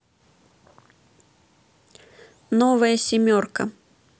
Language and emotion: Russian, neutral